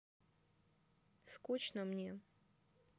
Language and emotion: Russian, sad